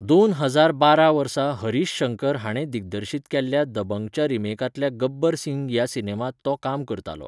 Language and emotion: Goan Konkani, neutral